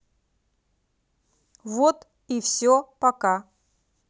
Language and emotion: Russian, neutral